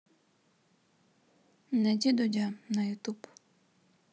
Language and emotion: Russian, neutral